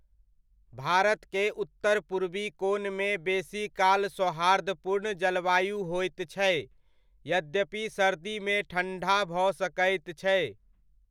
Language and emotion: Maithili, neutral